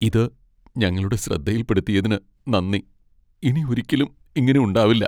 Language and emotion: Malayalam, sad